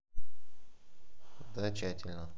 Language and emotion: Russian, neutral